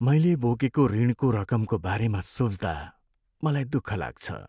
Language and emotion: Nepali, sad